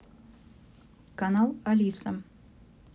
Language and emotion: Russian, neutral